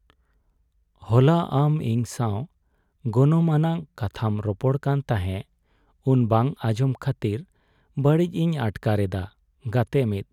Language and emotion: Santali, sad